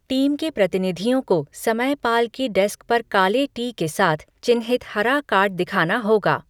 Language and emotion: Hindi, neutral